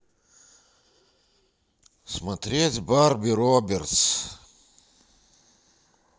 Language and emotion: Russian, neutral